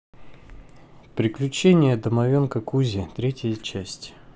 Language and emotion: Russian, neutral